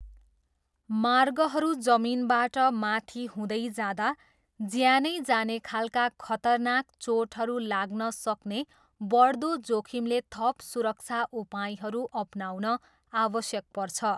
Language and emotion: Nepali, neutral